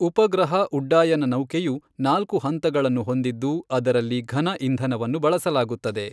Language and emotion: Kannada, neutral